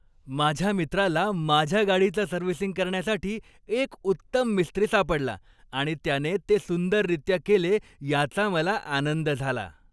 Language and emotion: Marathi, happy